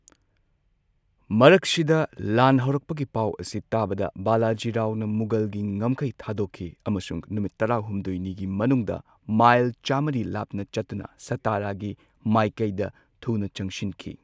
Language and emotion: Manipuri, neutral